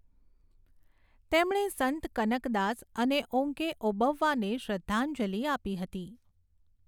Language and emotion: Gujarati, neutral